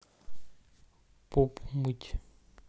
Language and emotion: Russian, neutral